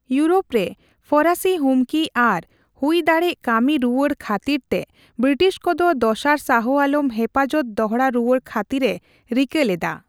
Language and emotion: Santali, neutral